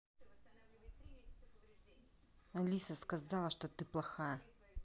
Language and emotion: Russian, angry